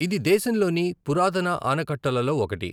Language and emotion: Telugu, neutral